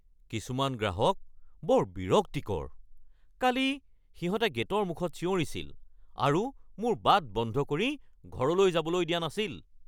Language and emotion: Assamese, angry